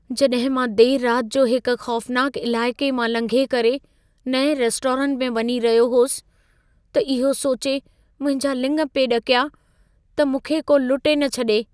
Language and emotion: Sindhi, fearful